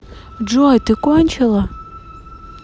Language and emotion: Russian, neutral